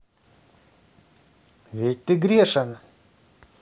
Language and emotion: Russian, neutral